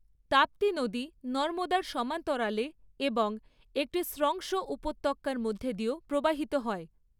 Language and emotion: Bengali, neutral